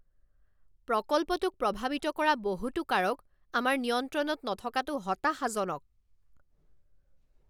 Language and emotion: Assamese, angry